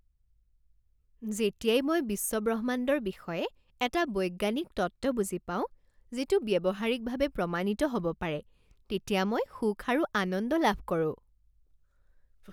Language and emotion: Assamese, happy